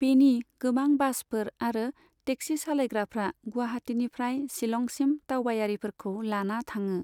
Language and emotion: Bodo, neutral